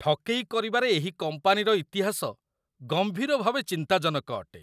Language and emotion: Odia, disgusted